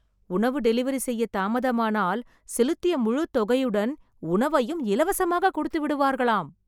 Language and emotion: Tamil, surprised